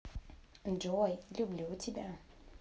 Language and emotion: Russian, positive